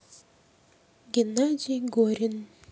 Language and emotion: Russian, neutral